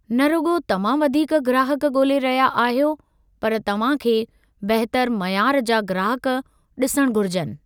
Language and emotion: Sindhi, neutral